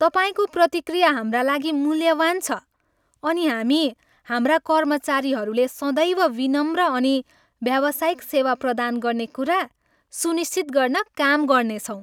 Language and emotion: Nepali, happy